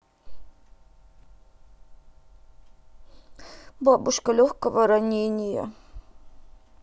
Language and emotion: Russian, sad